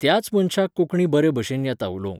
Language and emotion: Goan Konkani, neutral